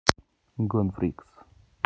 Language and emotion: Russian, neutral